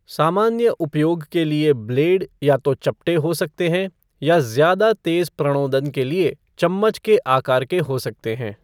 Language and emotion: Hindi, neutral